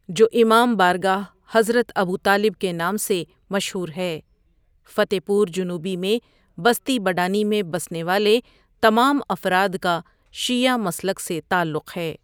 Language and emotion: Urdu, neutral